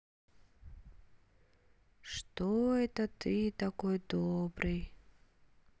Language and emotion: Russian, sad